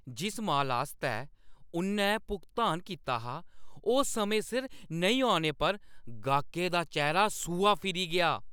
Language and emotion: Dogri, angry